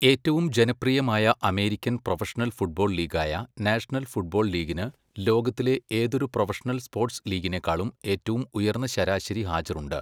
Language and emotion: Malayalam, neutral